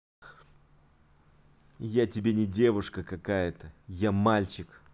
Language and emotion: Russian, angry